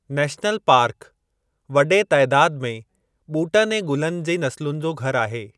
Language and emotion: Sindhi, neutral